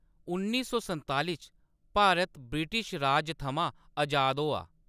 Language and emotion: Dogri, neutral